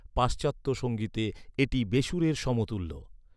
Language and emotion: Bengali, neutral